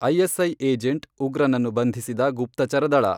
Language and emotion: Kannada, neutral